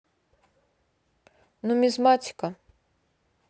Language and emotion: Russian, neutral